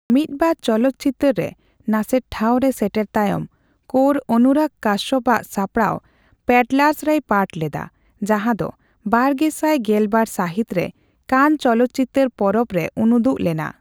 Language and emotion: Santali, neutral